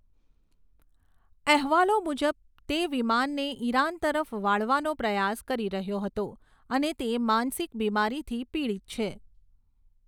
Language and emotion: Gujarati, neutral